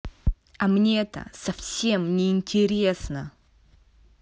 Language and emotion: Russian, angry